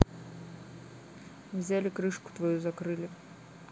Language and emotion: Russian, neutral